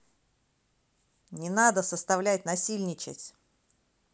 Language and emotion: Russian, angry